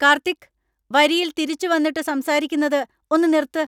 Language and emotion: Malayalam, angry